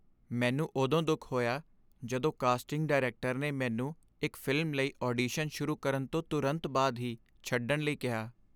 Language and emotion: Punjabi, sad